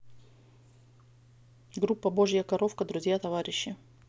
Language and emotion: Russian, neutral